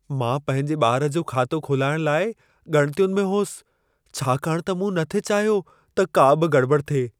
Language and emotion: Sindhi, fearful